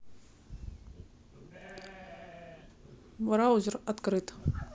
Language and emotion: Russian, neutral